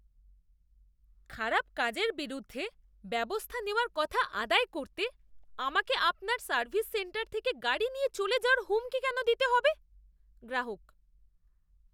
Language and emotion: Bengali, disgusted